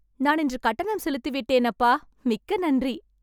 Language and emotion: Tamil, happy